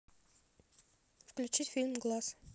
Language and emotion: Russian, neutral